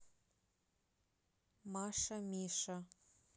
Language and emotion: Russian, neutral